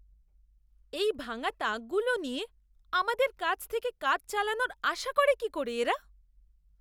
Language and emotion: Bengali, disgusted